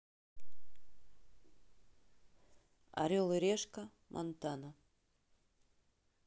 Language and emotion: Russian, neutral